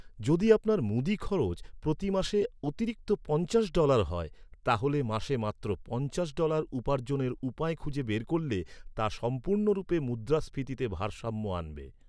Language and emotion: Bengali, neutral